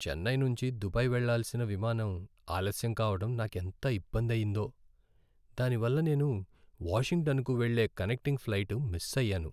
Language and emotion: Telugu, sad